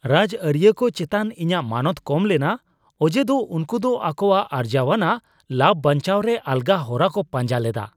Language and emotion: Santali, disgusted